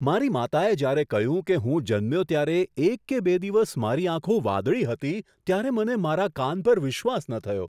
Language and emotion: Gujarati, surprised